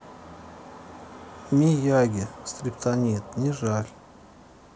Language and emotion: Russian, sad